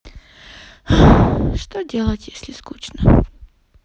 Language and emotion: Russian, sad